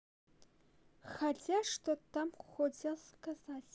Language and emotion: Russian, neutral